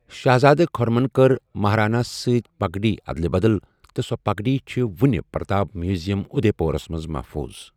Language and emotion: Kashmiri, neutral